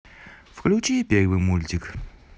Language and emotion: Russian, positive